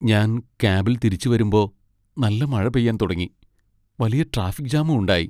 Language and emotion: Malayalam, sad